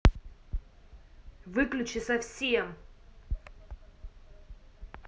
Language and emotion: Russian, angry